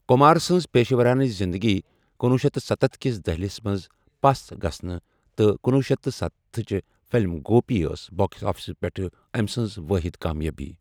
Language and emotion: Kashmiri, neutral